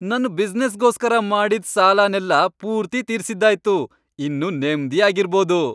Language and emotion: Kannada, happy